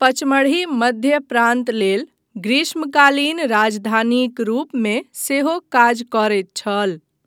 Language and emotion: Maithili, neutral